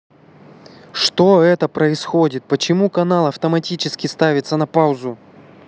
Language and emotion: Russian, angry